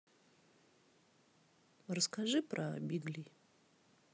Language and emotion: Russian, neutral